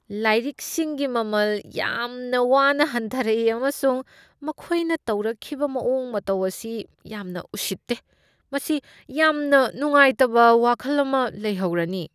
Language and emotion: Manipuri, disgusted